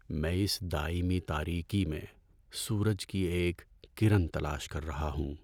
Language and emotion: Urdu, sad